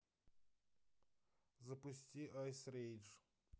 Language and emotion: Russian, neutral